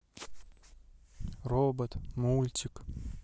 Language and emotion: Russian, neutral